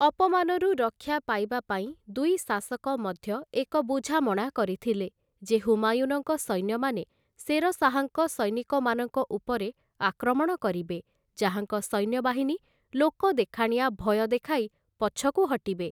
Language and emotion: Odia, neutral